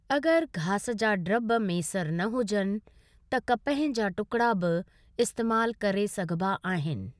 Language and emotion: Sindhi, neutral